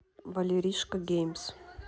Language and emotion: Russian, neutral